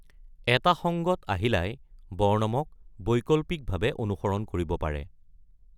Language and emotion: Assamese, neutral